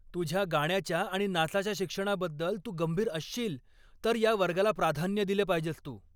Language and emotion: Marathi, angry